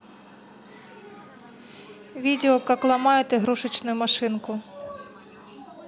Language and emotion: Russian, neutral